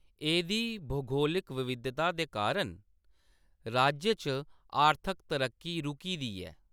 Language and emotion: Dogri, neutral